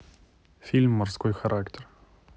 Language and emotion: Russian, neutral